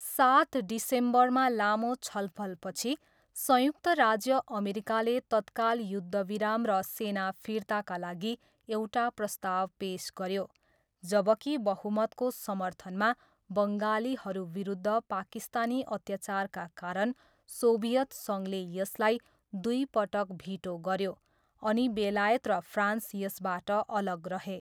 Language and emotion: Nepali, neutral